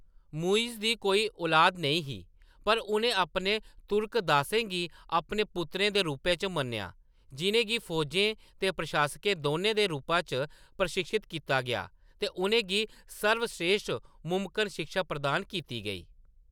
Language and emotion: Dogri, neutral